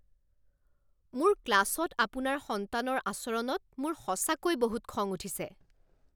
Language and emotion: Assamese, angry